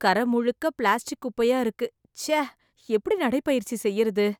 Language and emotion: Tamil, disgusted